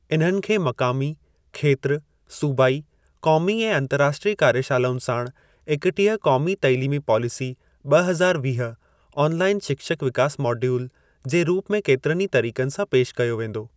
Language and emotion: Sindhi, neutral